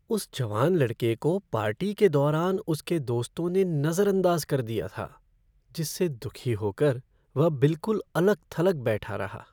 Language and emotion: Hindi, sad